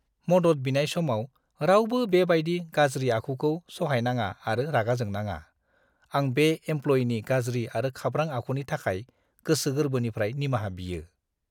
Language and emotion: Bodo, disgusted